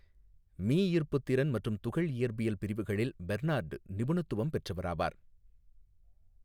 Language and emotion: Tamil, neutral